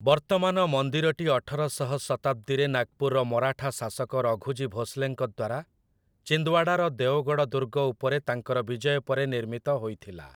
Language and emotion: Odia, neutral